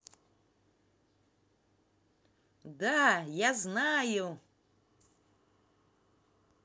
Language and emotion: Russian, positive